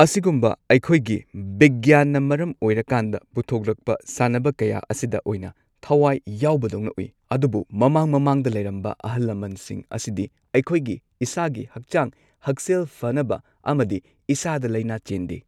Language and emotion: Manipuri, neutral